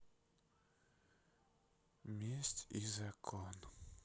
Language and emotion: Russian, sad